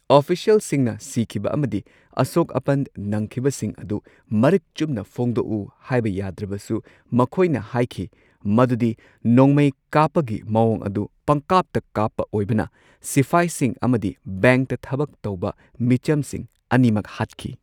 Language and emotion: Manipuri, neutral